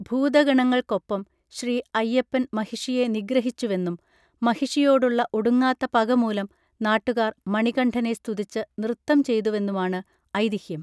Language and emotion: Malayalam, neutral